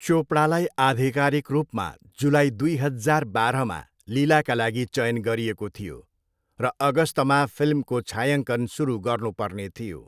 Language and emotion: Nepali, neutral